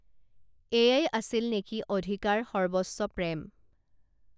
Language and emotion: Assamese, neutral